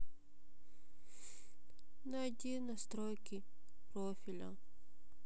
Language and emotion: Russian, sad